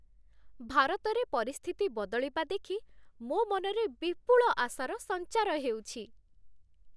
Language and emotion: Odia, happy